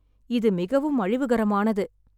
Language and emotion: Tamil, sad